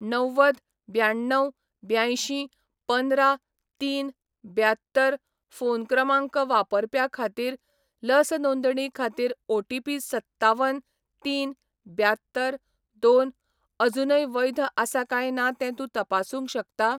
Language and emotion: Goan Konkani, neutral